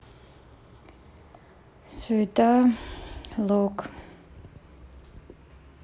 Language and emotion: Russian, sad